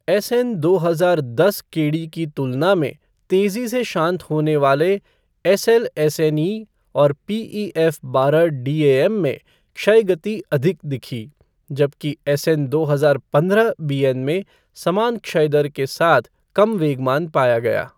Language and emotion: Hindi, neutral